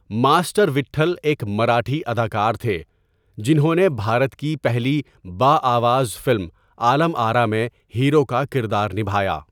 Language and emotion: Urdu, neutral